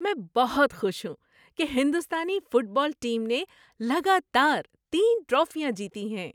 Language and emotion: Urdu, happy